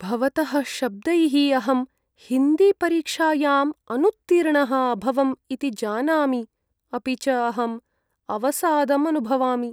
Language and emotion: Sanskrit, sad